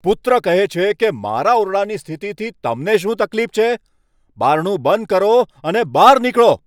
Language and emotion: Gujarati, angry